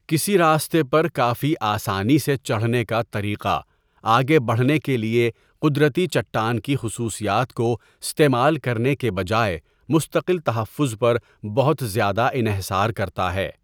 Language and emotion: Urdu, neutral